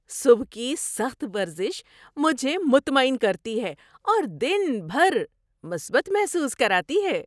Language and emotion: Urdu, happy